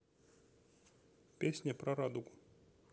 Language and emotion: Russian, neutral